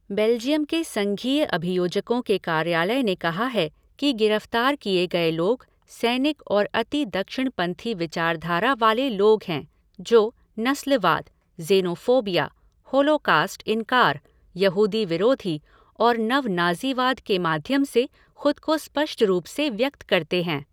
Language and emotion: Hindi, neutral